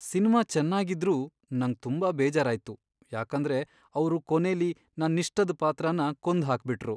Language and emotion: Kannada, sad